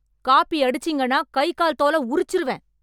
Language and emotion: Tamil, angry